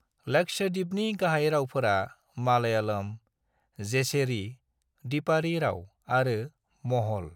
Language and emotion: Bodo, neutral